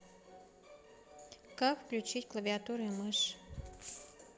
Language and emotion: Russian, neutral